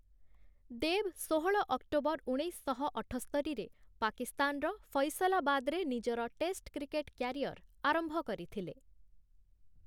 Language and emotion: Odia, neutral